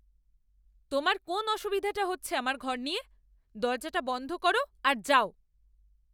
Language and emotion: Bengali, angry